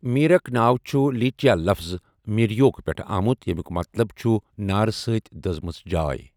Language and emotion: Kashmiri, neutral